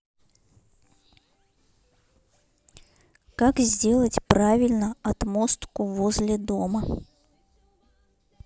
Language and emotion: Russian, neutral